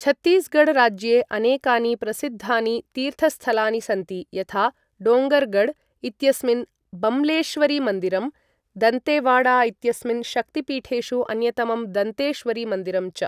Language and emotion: Sanskrit, neutral